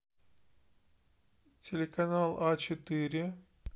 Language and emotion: Russian, neutral